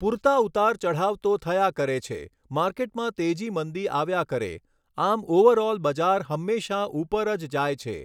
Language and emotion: Gujarati, neutral